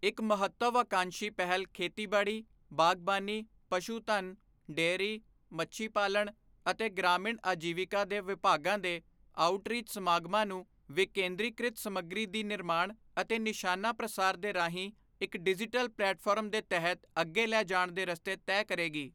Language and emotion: Punjabi, neutral